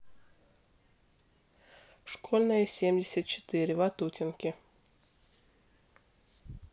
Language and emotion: Russian, neutral